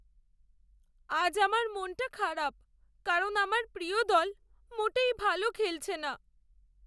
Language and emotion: Bengali, sad